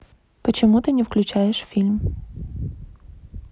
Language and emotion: Russian, neutral